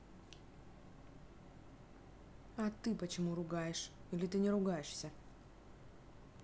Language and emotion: Russian, angry